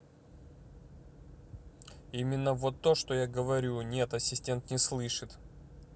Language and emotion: Russian, neutral